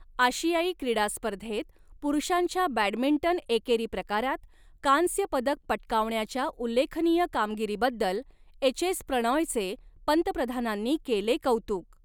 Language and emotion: Marathi, neutral